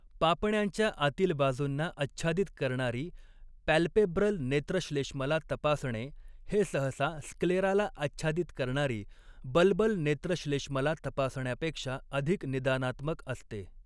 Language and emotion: Marathi, neutral